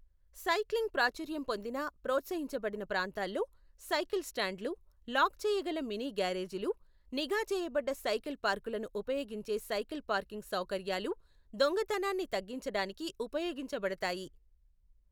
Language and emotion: Telugu, neutral